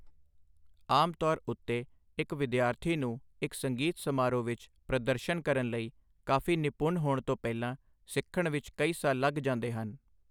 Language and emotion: Punjabi, neutral